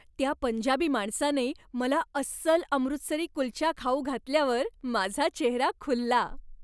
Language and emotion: Marathi, happy